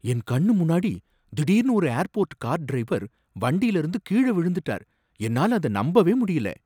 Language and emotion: Tamil, surprised